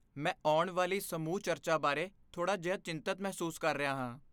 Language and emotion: Punjabi, fearful